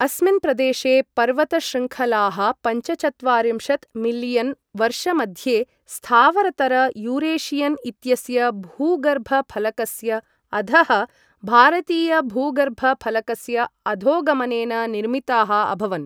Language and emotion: Sanskrit, neutral